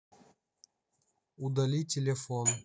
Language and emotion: Russian, neutral